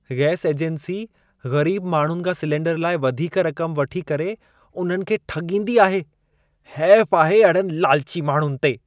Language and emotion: Sindhi, disgusted